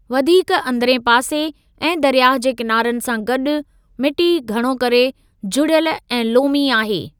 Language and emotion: Sindhi, neutral